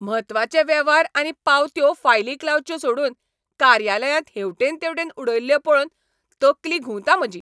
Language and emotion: Goan Konkani, angry